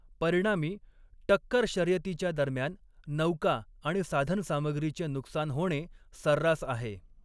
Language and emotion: Marathi, neutral